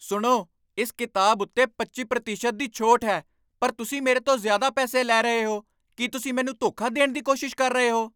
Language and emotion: Punjabi, angry